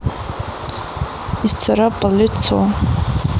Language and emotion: Russian, neutral